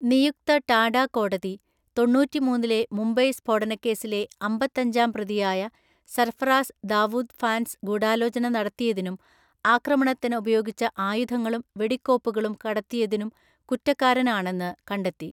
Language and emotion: Malayalam, neutral